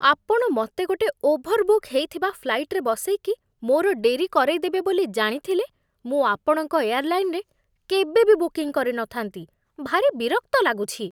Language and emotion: Odia, disgusted